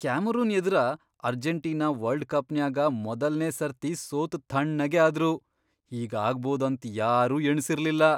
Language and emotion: Kannada, surprised